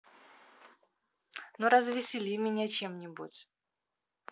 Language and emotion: Russian, positive